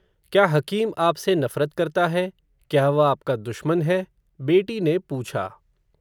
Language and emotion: Hindi, neutral